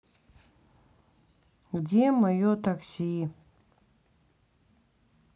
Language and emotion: Russian, sad